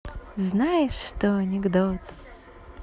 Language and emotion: Russian, positive